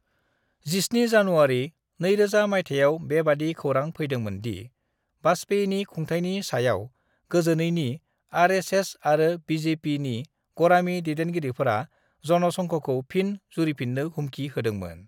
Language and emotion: Bodo, neutral